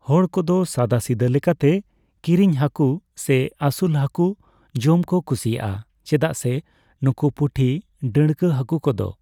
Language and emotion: Santali, neutral